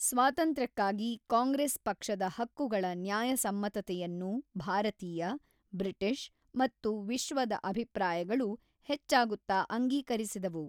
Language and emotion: Kannada, neutral